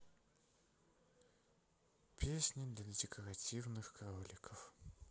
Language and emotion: Russian, sad